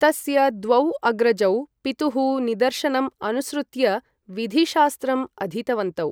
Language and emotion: Sanskrit, neutral